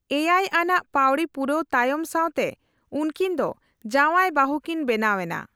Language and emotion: Santali, neutral